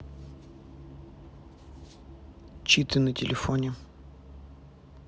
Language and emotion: Russian, neutral